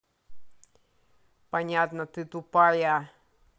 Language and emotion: Russian, angry